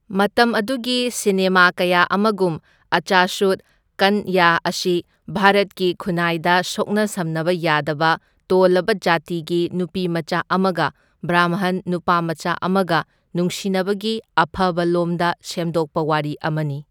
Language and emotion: Manipuri, neutral